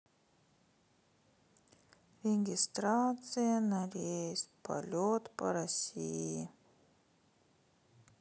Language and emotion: Russian, sad